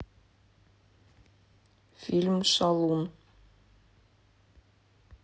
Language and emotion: Russian, neutral